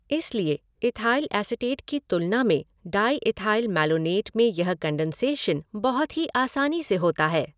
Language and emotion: Hindi, neutral